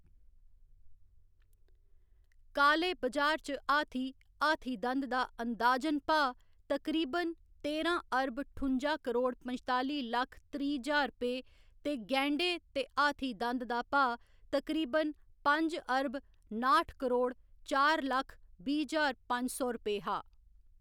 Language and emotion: Dogri, neutral